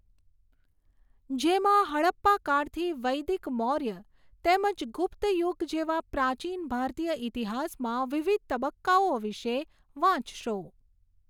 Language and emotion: Gujarati, neutral